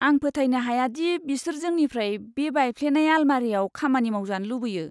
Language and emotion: Bodo, disgusted